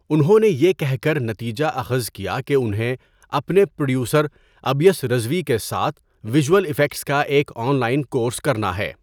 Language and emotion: Urdu, neutral